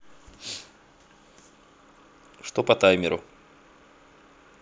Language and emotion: Russian, neutral